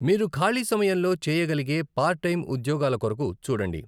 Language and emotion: Telugu, neutral